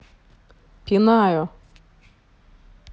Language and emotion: Russian, neutral